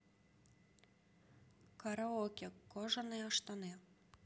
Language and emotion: Russian, neutral